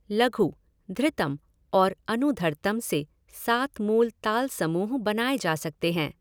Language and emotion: Hindi, neutral